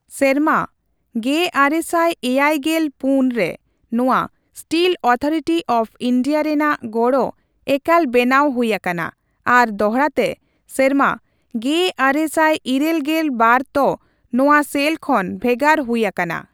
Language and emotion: Santali, neutral